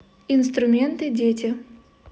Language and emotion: Russian, neutral